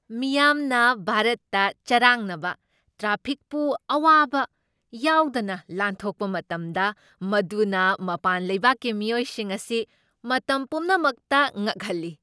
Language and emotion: Manipuri, surprised